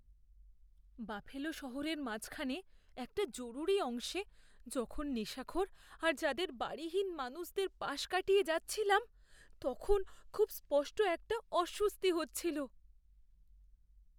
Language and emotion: Bengali, fearful